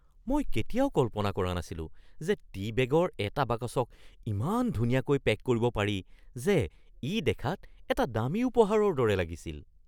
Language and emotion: Assamese, surprised